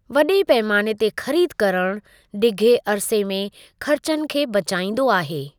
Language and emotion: Sindhi, neutral